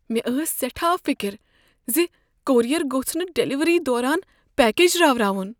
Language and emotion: Kashmiri, fearful